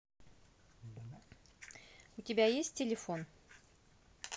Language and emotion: Russian, neutral